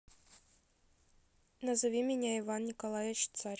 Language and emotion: Russian, neutral